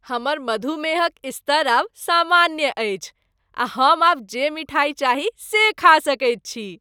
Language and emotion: Maithili, happy